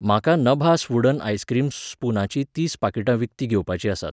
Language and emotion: Goan Konkani, neutral